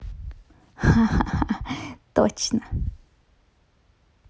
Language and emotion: Russian, positive